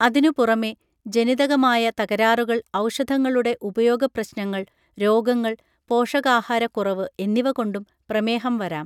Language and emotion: Malayalam, neutral